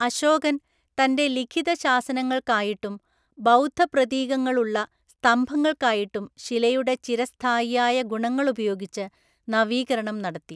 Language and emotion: Malayalam, neutral